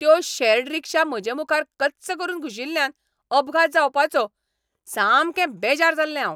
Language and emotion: Goan Konkani, angry